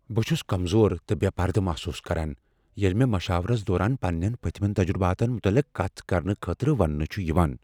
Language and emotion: Kashmiri, fearful